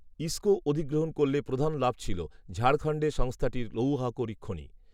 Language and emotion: Bengali, neutral